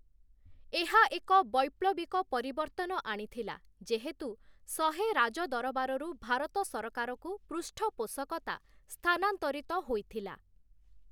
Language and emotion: Odia, neutral